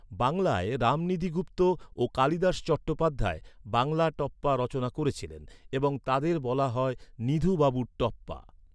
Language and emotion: Bengali, neutral